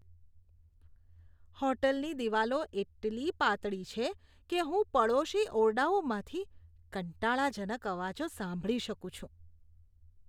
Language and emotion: Gujarati, disgusted